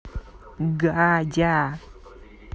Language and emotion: Russian, neutral